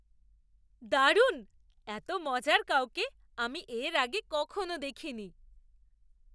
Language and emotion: Bengali, surprised